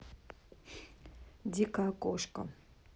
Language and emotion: Russian, neutral